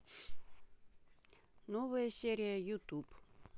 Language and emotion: Russian, neutral